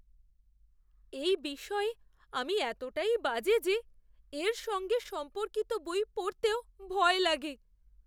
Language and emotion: Bengali, fearful